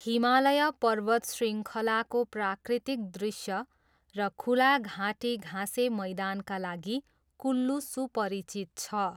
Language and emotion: Nepali, neutral